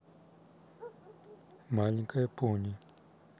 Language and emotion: Russian, neutral